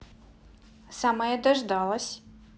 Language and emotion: Russian, positive